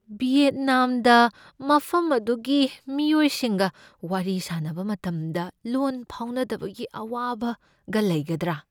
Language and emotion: Manipuri, fearful